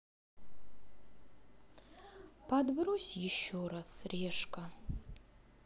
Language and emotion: Russian, sad